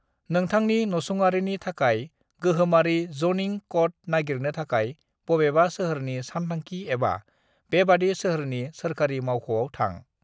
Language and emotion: Bodo, neutral